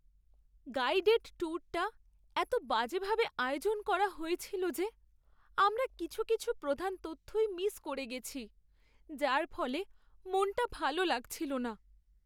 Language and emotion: Bengali, sad